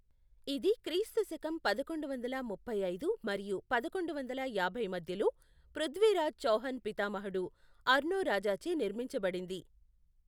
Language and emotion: Telugu, neutral